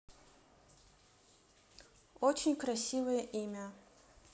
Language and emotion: Russian, neutral